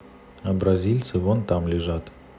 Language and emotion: Russian, neutral